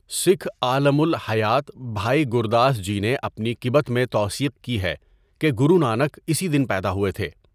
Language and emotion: Urdu, neutral